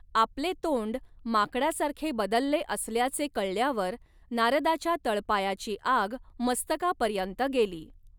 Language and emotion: Marathi, neutral